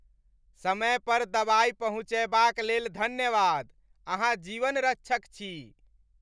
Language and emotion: Maithili, happy